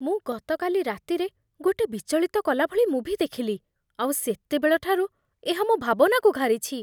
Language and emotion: Odia, fearful